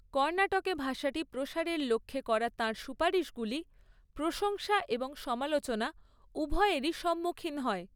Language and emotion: Bengali, neutral